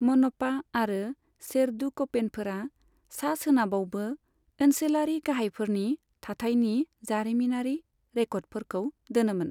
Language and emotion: Bodo, neutral